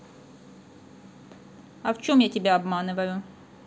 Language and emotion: Russian, neutral